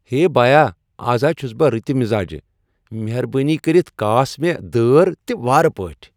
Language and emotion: Kashmiri, happy